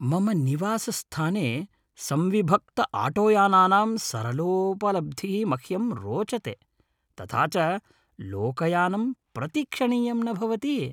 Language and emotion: Sanskrit, happy